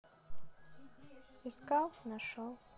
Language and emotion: Russian, neutral